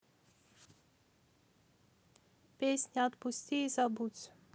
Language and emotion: Russian, neutral